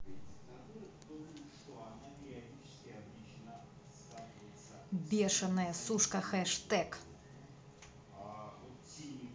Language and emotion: Russian, angry